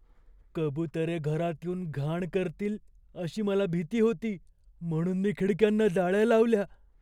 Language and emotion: Marathi, fearful